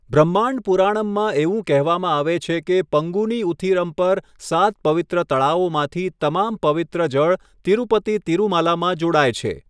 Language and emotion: Gujarati, neutral